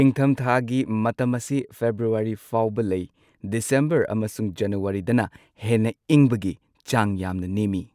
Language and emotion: Manipuri, neutral